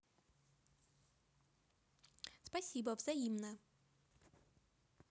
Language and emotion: Russian, positive